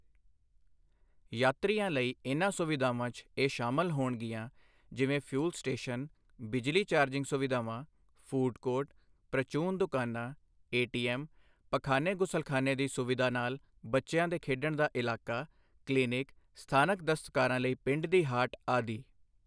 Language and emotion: Punjabi, neutral